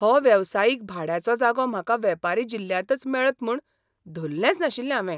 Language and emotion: Goan Konkani, surprised